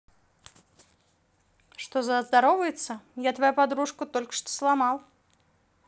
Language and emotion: Russian, neutral